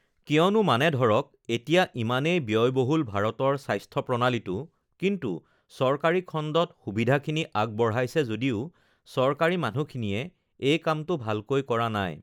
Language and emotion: Assamese, neutral